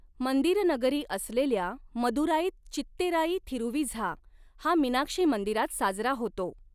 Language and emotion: Marathi, neutral